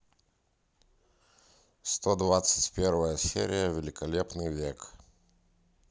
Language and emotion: Russian, neutral